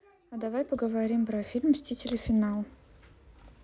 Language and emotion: Russian, neutral